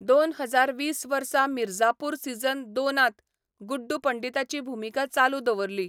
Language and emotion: Goan Konkani, neutral